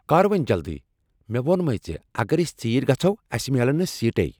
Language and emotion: Kashmiri, angry